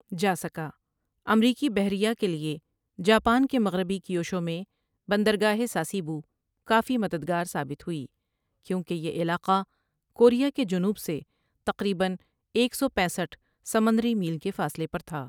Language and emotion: Urdu, neutral